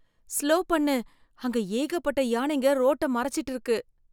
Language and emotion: Tamil, fearful